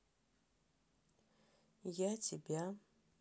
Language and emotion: Russian, neutral